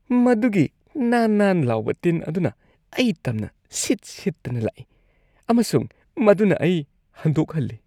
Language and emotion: Manipuri, disgusted